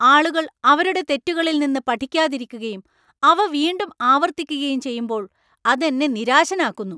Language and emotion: Malayalam, angry